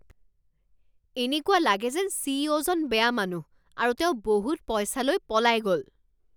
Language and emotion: Assamese, angry